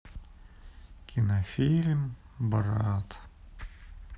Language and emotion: Russian, sad